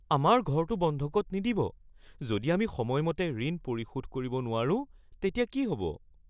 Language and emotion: Assamese, fearful